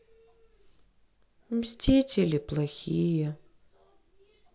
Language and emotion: Russian, sad